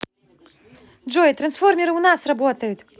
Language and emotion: Russian, positive